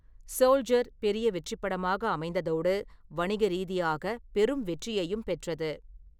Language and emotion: Tamil, neutral